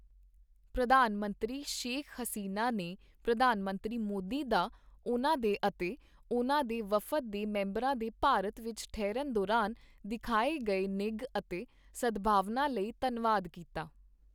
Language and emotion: Punjabi, neutral